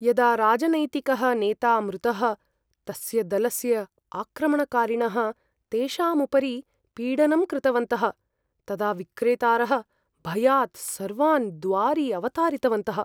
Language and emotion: Sanskrit, fearful